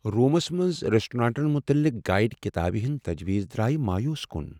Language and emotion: Kashmiri, sad